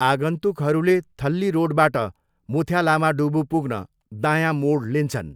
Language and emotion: Nepali, neutral